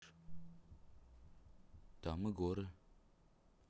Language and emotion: Russian, neutral